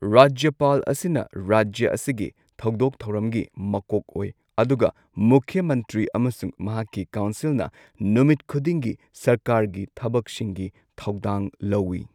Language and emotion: Manipuri, neutral